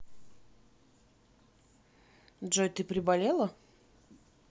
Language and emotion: Russian, neutral